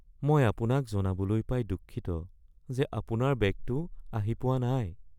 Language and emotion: Assamese, sad